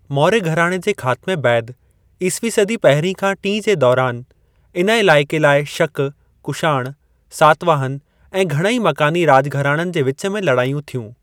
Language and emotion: Sindhi, neutral